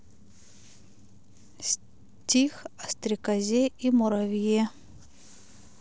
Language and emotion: Russian, neutral